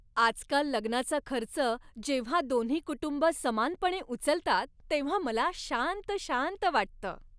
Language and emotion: Marathi, happy